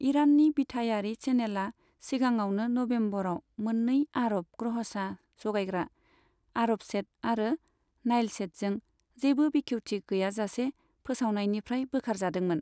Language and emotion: Bodo, neutral